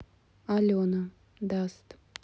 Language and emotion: Russian, sad